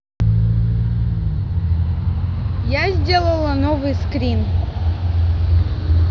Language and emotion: Russian, neutral